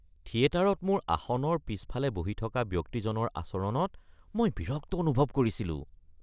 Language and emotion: Assamese, disgusted